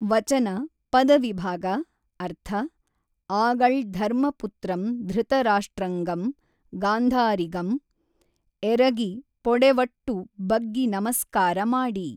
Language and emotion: Kannada, neutral